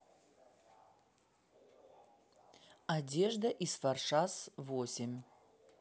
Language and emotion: Russian, neutral